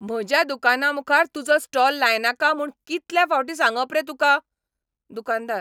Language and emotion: Goan Konkani, angry